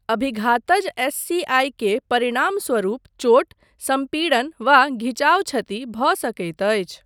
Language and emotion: Maithili, neutral